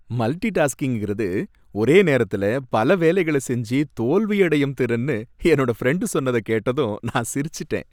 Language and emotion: Tamil, happy